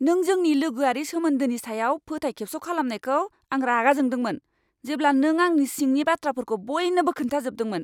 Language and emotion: Bodo, angry